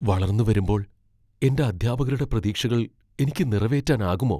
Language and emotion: Malayalam, fearful